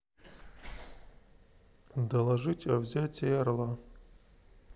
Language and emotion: Russian, neutral